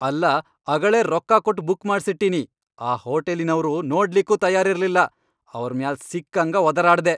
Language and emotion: Kannada, angry